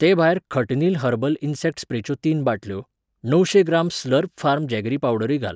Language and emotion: Goan Konkani, neutral